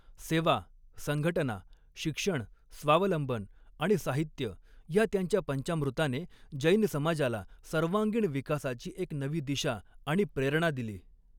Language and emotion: Marathi, neutral